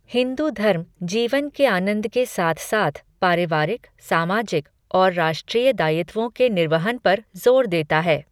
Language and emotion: Hindi, neutral